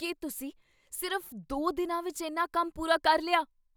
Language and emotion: Punjabi, surprised